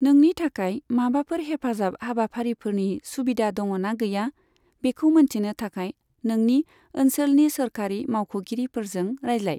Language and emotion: Bodo, neutral